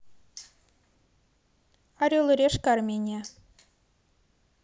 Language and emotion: Russian, neutral